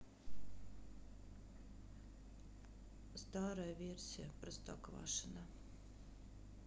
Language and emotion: Russian, sad